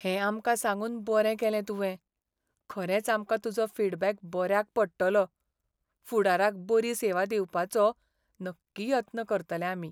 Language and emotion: Goan Konkani, sad